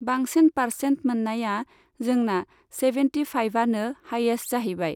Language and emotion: Bodo, neutral